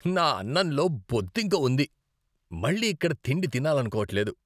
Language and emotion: Telugu, disgusted